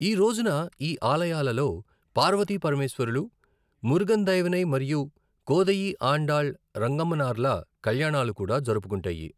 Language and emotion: Telugu, neutral